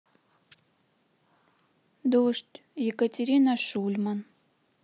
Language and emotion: Russian, sad